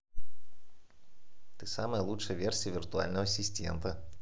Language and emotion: Russian, positive